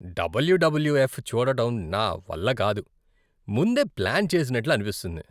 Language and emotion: Telugu, disgusted